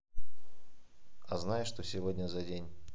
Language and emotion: Russian, neutral